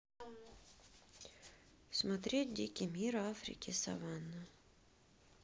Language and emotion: Russian, sad